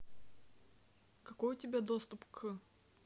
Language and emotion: Russian, neutral